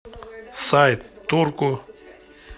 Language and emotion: Russian, neutral